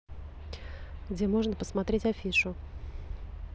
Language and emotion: Russian, neutral